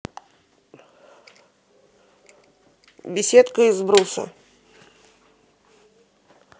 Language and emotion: Russian, neutral